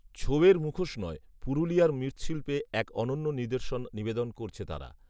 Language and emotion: Bengali, neutral